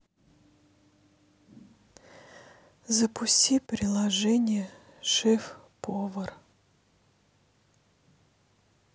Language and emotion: Russian, sad